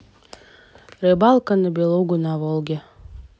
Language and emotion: Russian, neutral